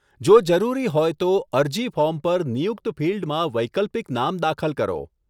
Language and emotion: Gujarati, neutral